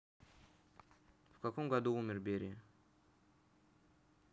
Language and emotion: Russian, neutral